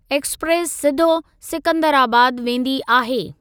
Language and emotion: Sindhi, neutral